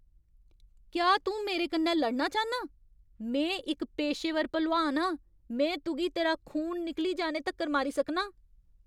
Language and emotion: Dogri, angry